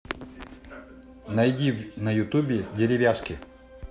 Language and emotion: Russian, positive